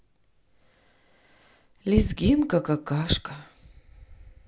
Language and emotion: Russian, sad